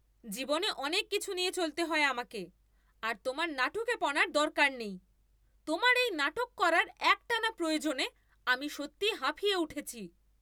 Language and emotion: Bengali, angry